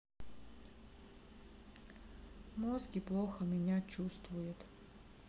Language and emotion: Russian, sad